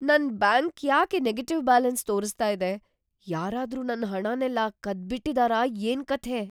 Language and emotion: Kannada, fearful